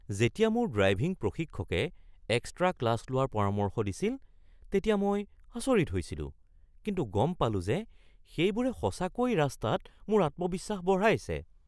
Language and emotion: Assamese, surprised